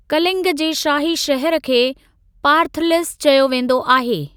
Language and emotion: Sindhi, neutral